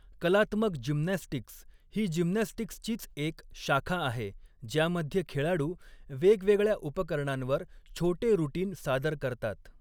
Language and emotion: Marathi, neutral